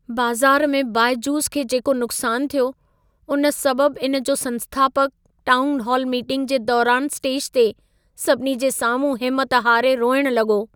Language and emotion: Sindhi, sad